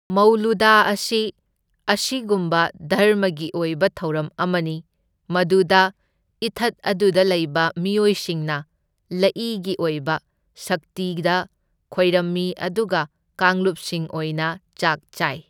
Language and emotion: Manipuri, neutral